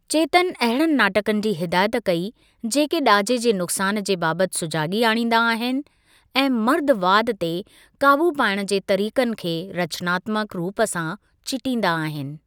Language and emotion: Sindhi, neutral